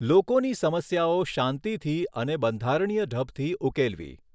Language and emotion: Gujarati, neutral